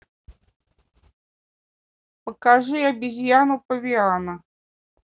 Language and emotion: Russian, neutral